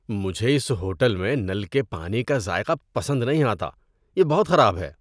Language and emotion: Urdu, disgusted